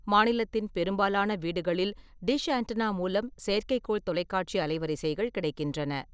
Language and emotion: Tamil, neutral